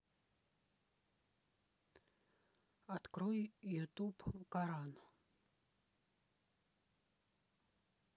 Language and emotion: Russian, neutral